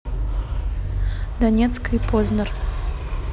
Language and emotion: Russian, neutral